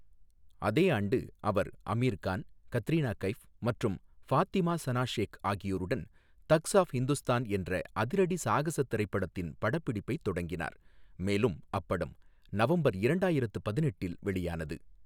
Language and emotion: Tamil, neutral